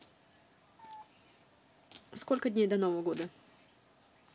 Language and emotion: Russian, neutral